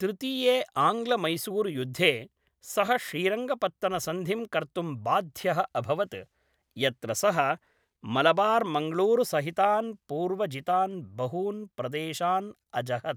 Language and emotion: Sanskrit, neutral